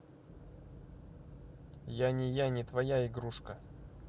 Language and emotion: Russian, neutral